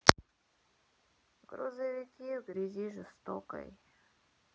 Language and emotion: Russian, sad